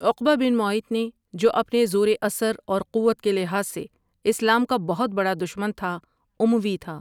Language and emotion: Urdu, neutral